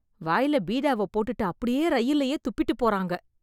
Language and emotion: Tamil, disgusted